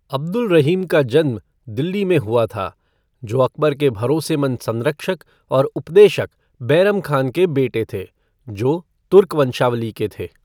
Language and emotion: Hindi, neutral